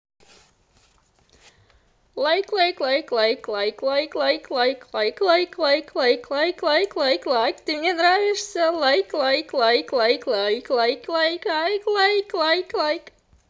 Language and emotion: Russian, positive